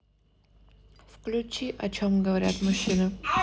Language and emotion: Russian, neutral